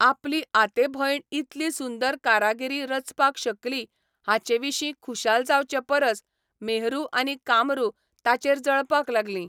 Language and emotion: Goan Konkani, neutral